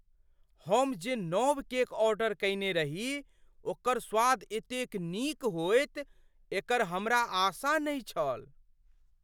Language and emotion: Maithili, surprised